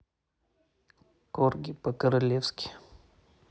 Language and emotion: Russian, neutral